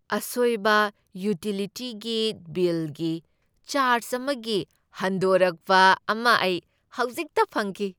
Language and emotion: Manipuri, happy